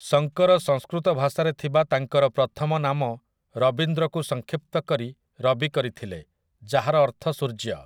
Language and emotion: Odia, neutral